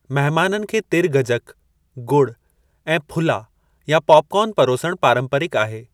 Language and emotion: Sindhi, neutral